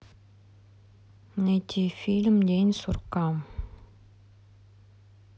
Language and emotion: Russian, sad